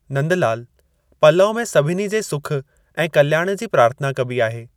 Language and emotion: Sindhi, neutral